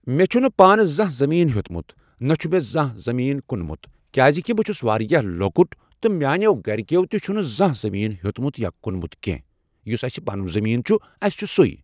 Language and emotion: Kashmiri, neutral